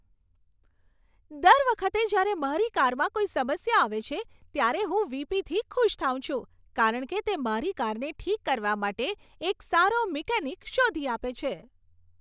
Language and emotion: Gujarati, happy